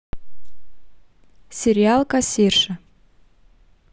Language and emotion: Russian, neutral